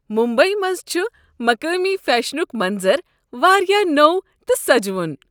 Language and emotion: Kashmiri, happy